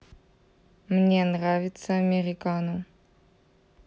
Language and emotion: Russian, neutral